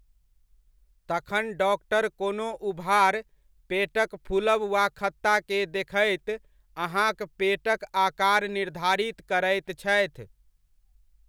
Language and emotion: Maithili, neutral